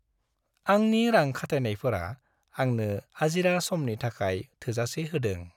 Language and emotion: Bodo, happy